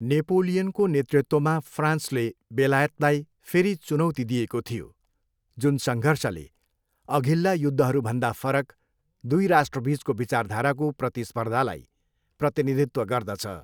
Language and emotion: Nepali, neutral